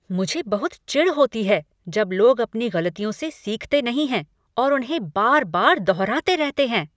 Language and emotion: Hindi, angry